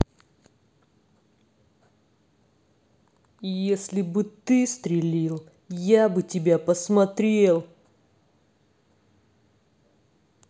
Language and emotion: Russian, angry